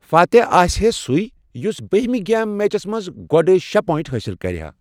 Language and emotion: Kashmiri, neutral